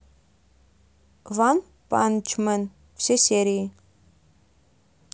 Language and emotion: Russian, neutral